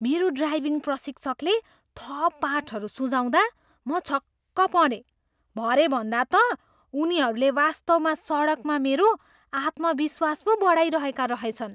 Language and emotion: Nepali, surprised